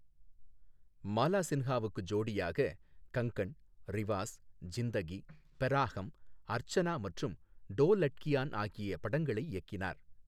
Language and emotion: Tamil, neutral